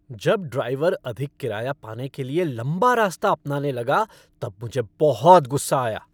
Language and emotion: Hindi, angry